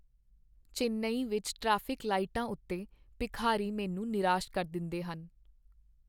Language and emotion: Punjabi, sad